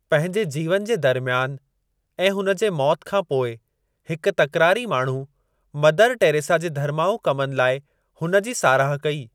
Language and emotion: Sindhi, neutral